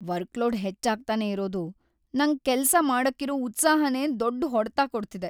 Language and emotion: Kannada, sad